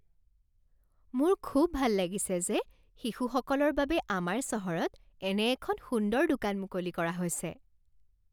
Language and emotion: Assamese, happy